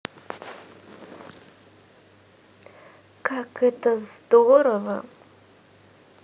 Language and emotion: Russian, positive